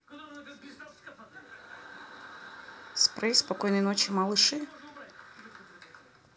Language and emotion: Russian, neutral